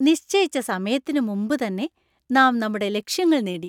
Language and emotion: Malayalam, happy